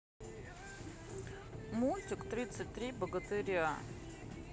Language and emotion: Russian, neutral